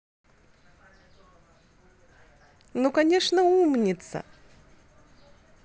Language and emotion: Russian, positive